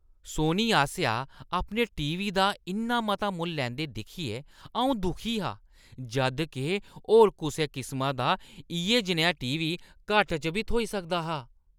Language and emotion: Dogri, disgusted